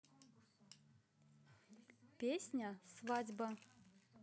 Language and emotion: Russian, neutral